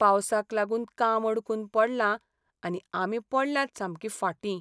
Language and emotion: Goan Konkani, sad